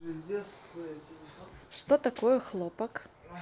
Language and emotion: Russian, neutral